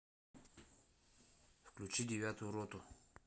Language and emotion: Russian, neutral